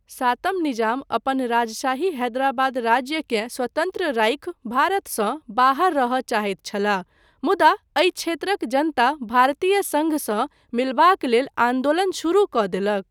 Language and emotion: Maithili, neutral